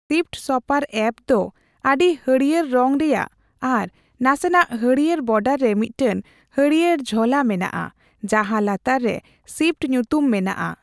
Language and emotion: Santali, neutral